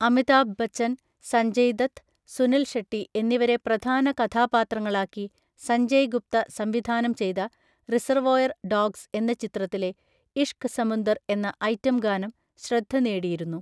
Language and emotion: Malayalam, neutral